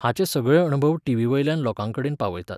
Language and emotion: Goan Konkani, neutral